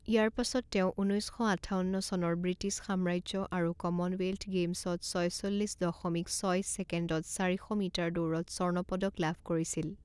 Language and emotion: Assamese, neutral